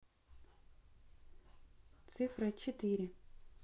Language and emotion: Russian, neutral